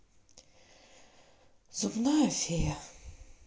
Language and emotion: Russian, sad